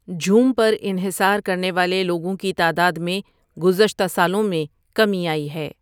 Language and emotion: Urdu, neutral